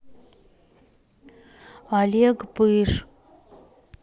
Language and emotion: Russian, neutral